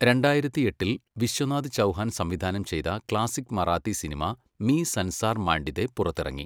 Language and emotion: Malayalam, neutral